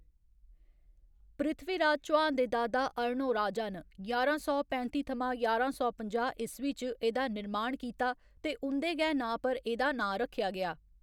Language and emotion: Dogri, neutral